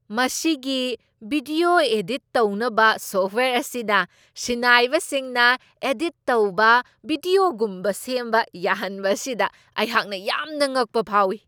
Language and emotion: Manipuri, surprised